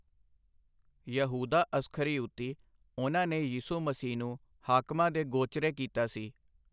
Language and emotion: Punjabi, neutral